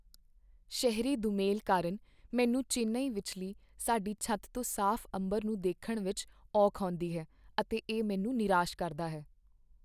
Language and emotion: Punjabi, sad